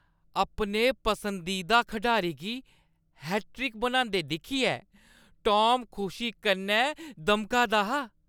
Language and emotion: Dogri, happy